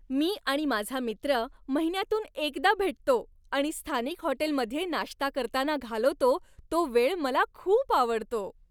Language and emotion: Marathi, happy